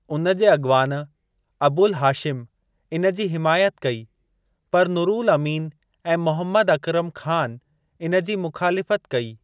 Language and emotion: Sindhi, neutral